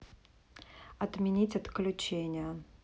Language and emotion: Russian, neutral